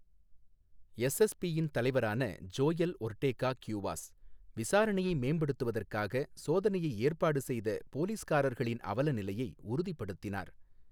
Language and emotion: Tamil, neutral